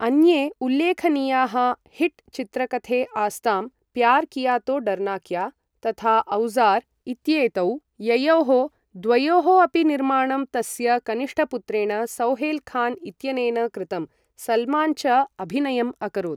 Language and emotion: Sanskrit, neutral